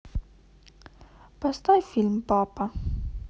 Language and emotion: Russian, sad